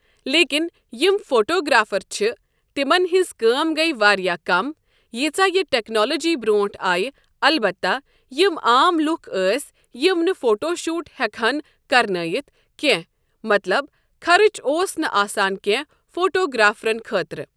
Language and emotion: Kashmiri, neutral